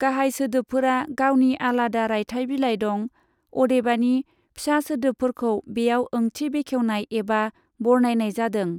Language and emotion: Bodo, neutral